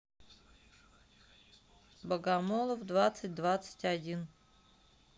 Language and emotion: Russian, neutral